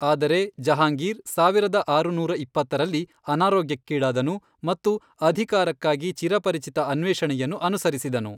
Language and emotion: Kannada, neutral